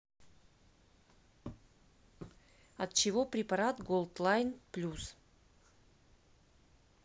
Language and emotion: Russian, neutral